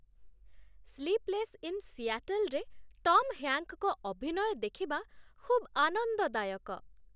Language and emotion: Odia, happy